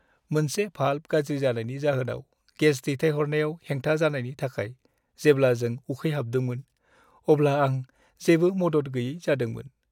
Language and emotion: Bodo, sad